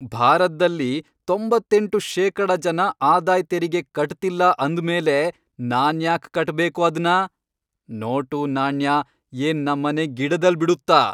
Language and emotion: Kannada, angry